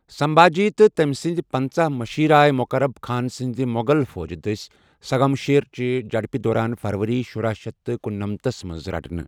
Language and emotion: Kashmiri, neutral